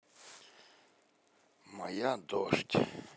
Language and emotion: Russian, neutral